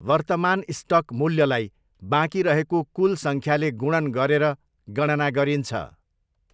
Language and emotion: Nepali, neutral